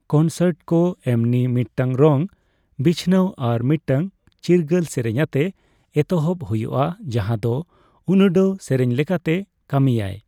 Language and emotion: Santali, neutral